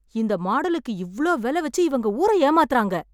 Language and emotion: Tamil, angry